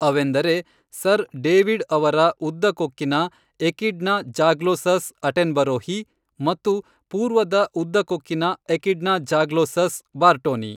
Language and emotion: Kannada, neutral